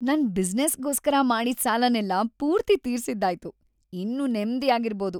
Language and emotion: Kannada, happy